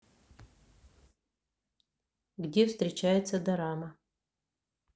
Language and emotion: Russian, neutral